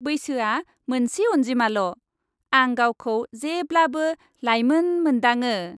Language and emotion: Bodo, happy